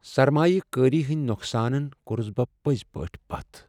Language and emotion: Kashmiri, sad